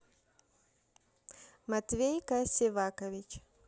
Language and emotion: Russian, neutral